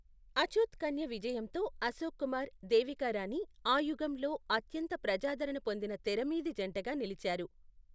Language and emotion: Telugu, neutral